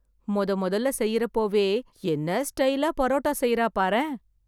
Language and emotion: Tamil, surprised